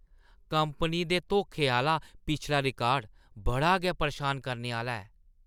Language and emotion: Dogri, disgusted